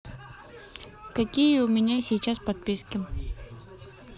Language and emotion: Russian, neutral